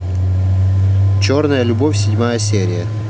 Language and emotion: Russian, neutral